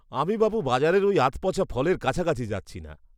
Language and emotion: Bengali, disgusted